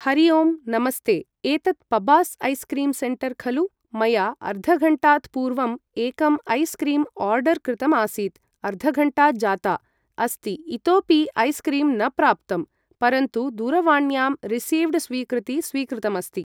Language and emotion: Sanskrit, neutral